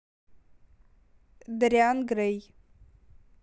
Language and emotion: Russian, neutral